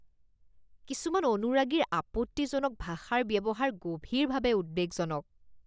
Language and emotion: Assamese, disgusted